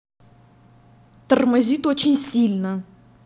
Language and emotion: Russian, angry